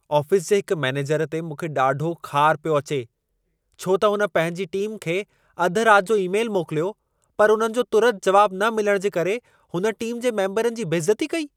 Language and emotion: Sindhi, angry